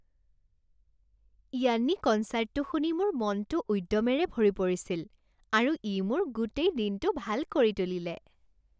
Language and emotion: Assamese, happy